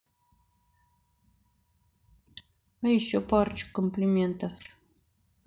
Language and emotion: Russian, neutral